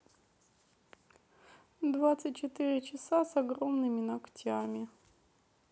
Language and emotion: Russian, sad